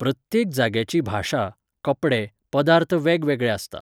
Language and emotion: Goan Konkani, neutral